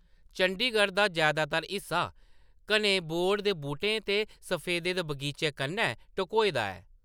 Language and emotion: Dogri, neutral